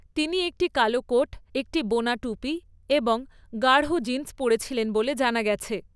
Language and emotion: Bengali, neutral